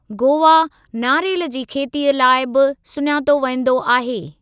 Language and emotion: Sindhi, neutral